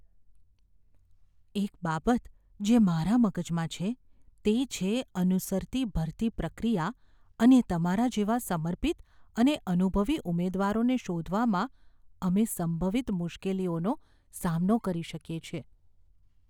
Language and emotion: Gujarati, fearful